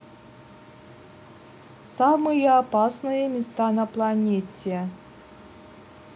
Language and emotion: Russian, neutral